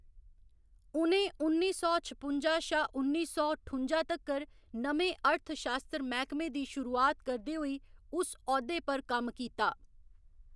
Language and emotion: Dogri, neutral